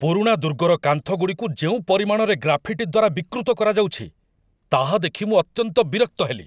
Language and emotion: Odia, angry